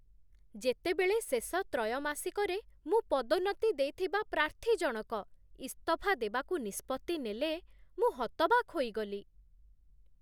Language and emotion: Odia, surprised